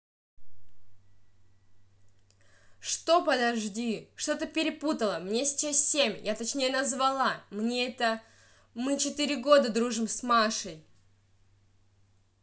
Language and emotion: Russian, angry